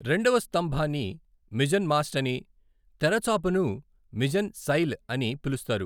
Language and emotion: Telugu, neutral